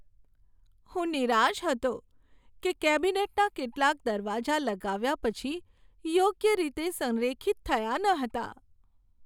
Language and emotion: Gujarati, sad